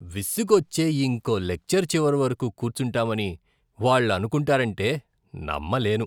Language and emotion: Telugu, disgusted